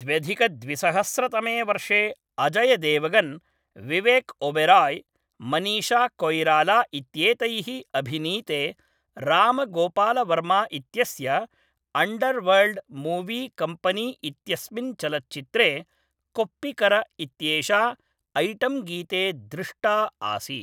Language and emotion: Sanskrit, neutral